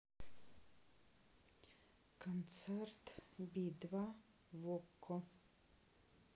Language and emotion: Russian, neutral